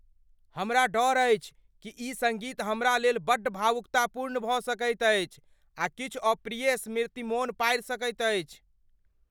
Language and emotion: Maithili, fearful